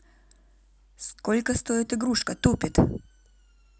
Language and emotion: Russian, neutral